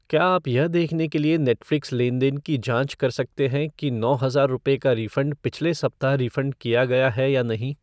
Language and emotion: Hindi, neutral